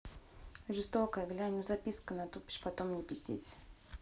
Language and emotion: Russian, neutral